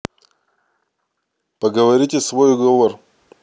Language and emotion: Russian, neutral